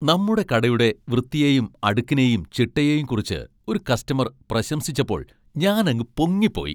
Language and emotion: Malayalam, happy